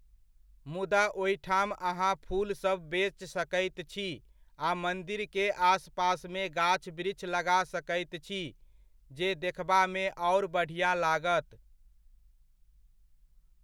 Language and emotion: Maithili, neutral